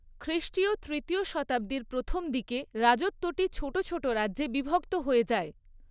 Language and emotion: Bengali, neutral